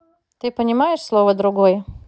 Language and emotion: Russian, neutral